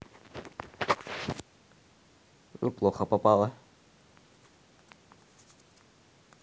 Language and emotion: Russian, neutral